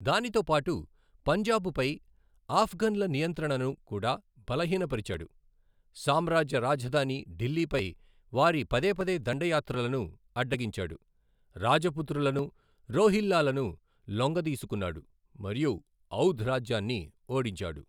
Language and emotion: Telugu, neutral